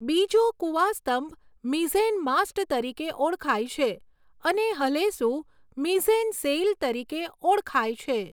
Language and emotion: Gujarati, neutral